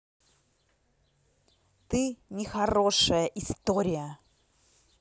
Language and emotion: Russian, angry